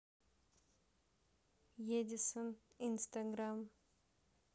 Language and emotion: Russian, neutral